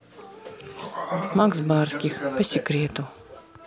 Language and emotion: Russian, neutral